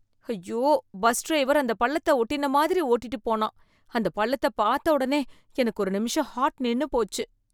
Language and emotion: Tamil, fearful